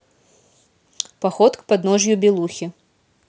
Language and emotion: Russian, neutral